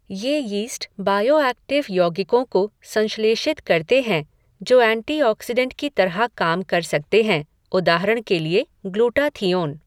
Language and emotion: Hindi, neutral